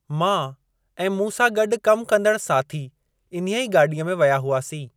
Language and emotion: Sindhi, neutral